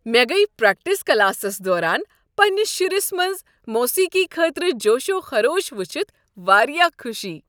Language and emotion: Kashmiri, happy